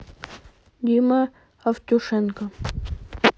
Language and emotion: Russian, neutral